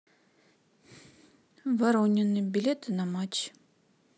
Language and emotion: Russian, neutral